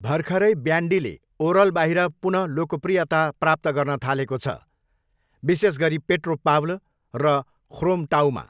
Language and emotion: Nepali, neutral